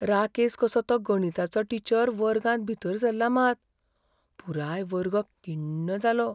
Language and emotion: Goan Konkani, fearful